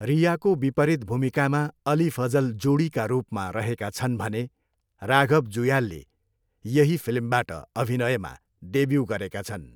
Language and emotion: Nepali, neutral